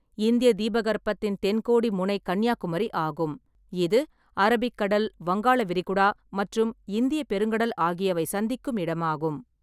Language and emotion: Tamil, neutral